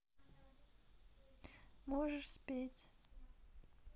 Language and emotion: Russian, sad